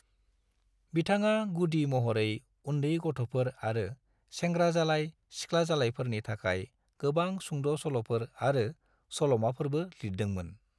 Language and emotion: Bodo, neutral